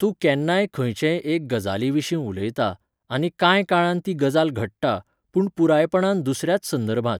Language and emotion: Goan Konkani, neutral